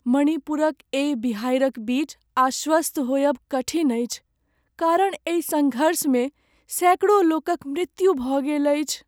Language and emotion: Maithili, sad